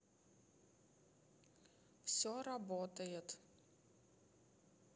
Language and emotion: Russian, neutral